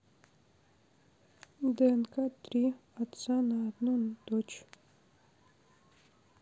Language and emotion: Russian, sad